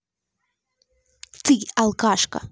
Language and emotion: Russian, angry